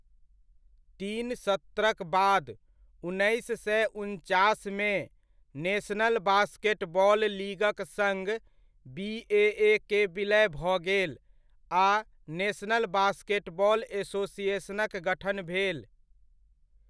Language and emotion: Maithili, neutral